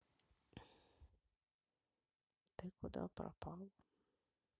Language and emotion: Russian, sad